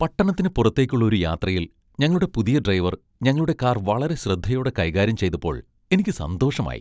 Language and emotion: Malayalam, happy